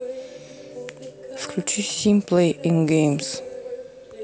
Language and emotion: Russian, neutral